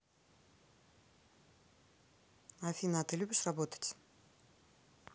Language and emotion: Russian, neutral